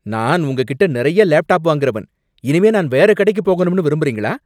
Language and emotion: Tamil, angry